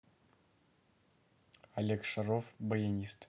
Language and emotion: Russian, neutral